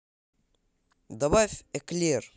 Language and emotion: Russian, positive